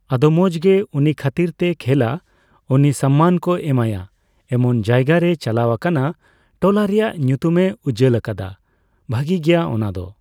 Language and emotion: Santali, neutral